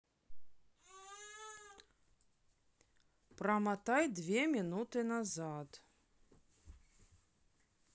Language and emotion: Russian, neutral